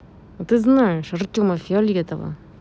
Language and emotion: Russian, angry